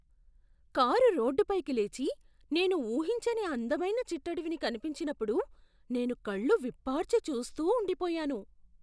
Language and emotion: Telugu, surprised